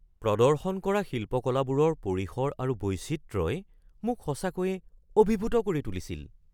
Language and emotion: Assamese, surprised